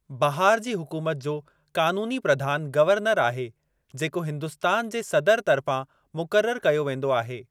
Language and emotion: Sindhi, neutral